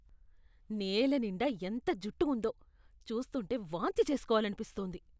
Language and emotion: Telugu, disgusted